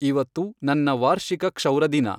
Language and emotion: Kannada, neutral